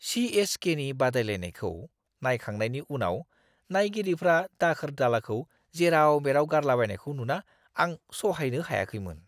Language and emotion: Bodo, disgusted